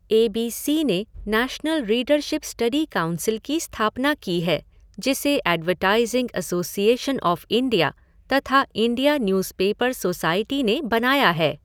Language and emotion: Hindi, neutral